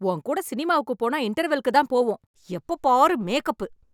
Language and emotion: Tamil, angry